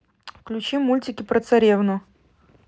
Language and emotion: Russian, neutral